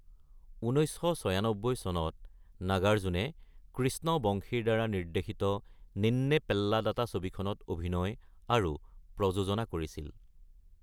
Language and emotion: Assamese, neutral